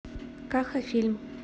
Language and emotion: Russian, neutral